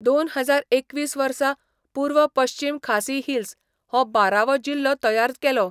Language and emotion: Goan Konkani, neutral